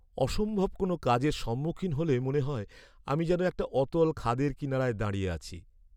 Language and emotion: Bengali, sad